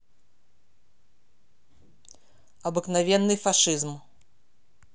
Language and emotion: Russian, angry